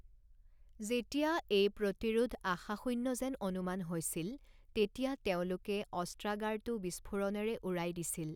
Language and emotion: Assamese, neutral